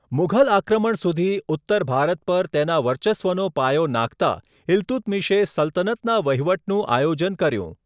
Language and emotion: Gujarati, neutral